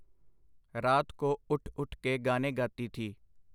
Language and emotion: Punjabi, neutral